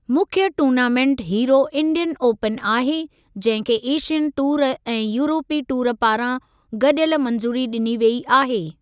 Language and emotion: Sindhi, neutral